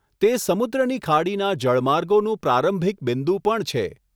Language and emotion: Gujarati, neutral